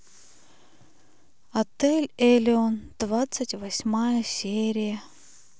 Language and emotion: Russian, sad